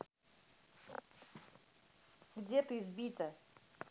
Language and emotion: Russian, neutral